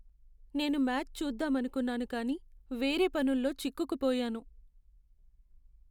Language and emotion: Telugu, sad